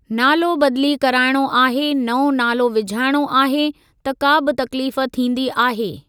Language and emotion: Sindhi, neutral